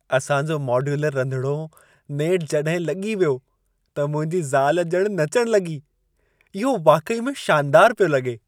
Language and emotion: Sindhi, happy